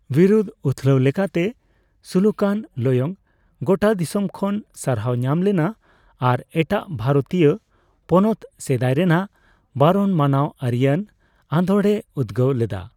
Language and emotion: Santali, neutral